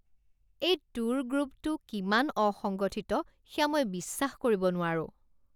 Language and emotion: Assamese, disgusted